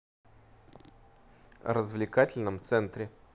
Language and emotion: Russian, neutral